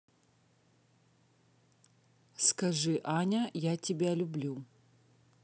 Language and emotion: Russian, neutral